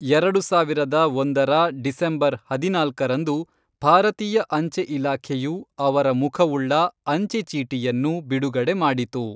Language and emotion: Kannada, neutral